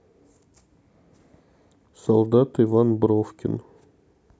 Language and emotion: Russian, neutral